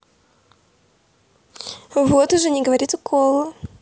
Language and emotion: Russian, positive